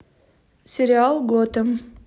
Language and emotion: Russian, neutral